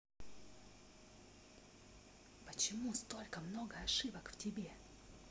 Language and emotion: Russian, angry